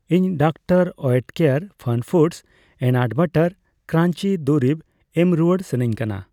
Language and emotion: Santali, neutral